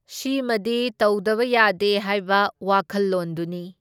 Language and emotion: Manipuri, neutral